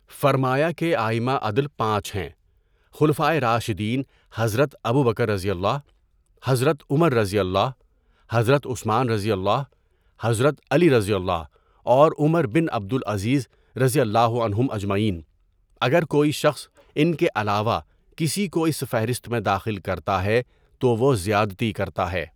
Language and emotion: Urdu, neutral